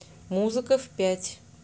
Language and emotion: Russian, neutral